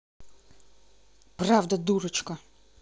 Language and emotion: Russian, angry